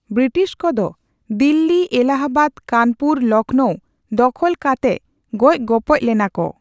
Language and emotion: Santali, neutral